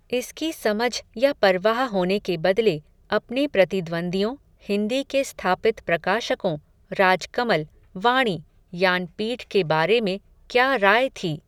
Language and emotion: Hindi, neutral